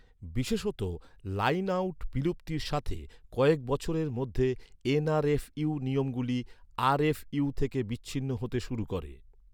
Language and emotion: Bengali, neutral